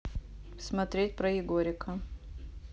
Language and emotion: Russian, neutral